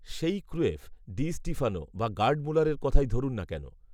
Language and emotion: Bengali, neutral